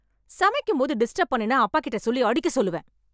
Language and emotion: Tamil, angry